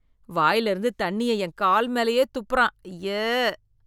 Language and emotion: Tamil, disgusted